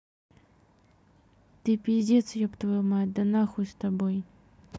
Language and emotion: Russian, neutral